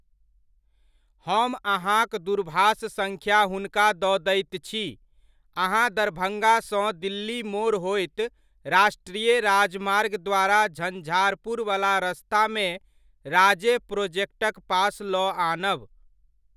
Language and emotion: Maithili, neutral